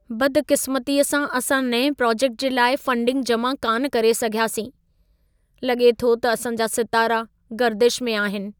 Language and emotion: Sindhi, sad